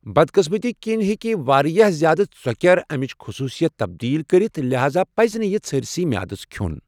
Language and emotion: Kashmiri, neutral